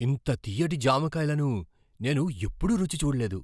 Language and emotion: Telugu, surprised